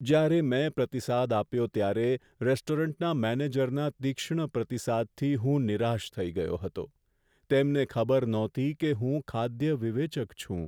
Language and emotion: Gujarati, sad